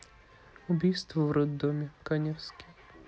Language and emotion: Russian, neutral